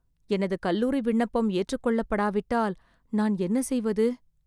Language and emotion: Tamil, fearful